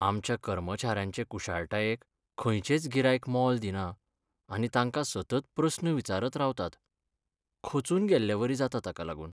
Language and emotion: Goan Konkani, sad